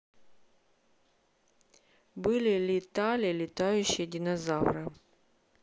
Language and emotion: Russian, neutral